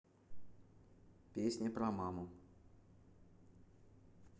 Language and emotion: Russian, neutral